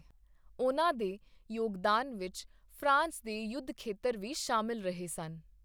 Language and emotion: Punjabi, neutral